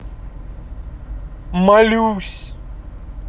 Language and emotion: Russian, sad